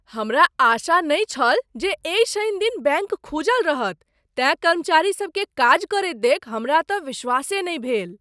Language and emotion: Maithili, surprised